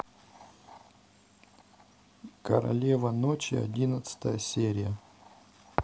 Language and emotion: Russian, neutral